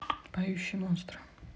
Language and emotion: Russian, neutral